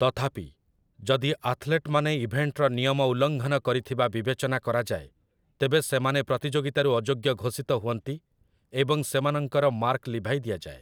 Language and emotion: Odia, neutral